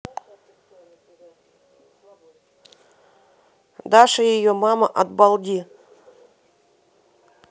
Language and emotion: Russian, neutral